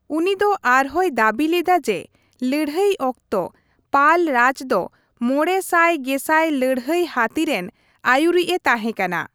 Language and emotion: Santali, neutral